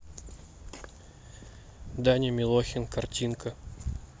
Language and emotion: Russian, neutral